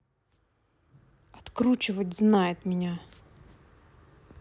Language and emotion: Russian, angry